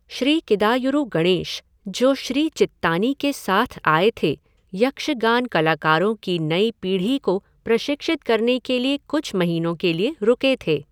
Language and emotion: Hindi, neutral